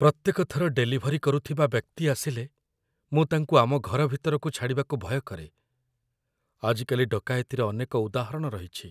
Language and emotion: Odia, fearful